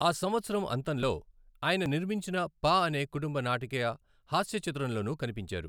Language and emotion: Telugu, neutral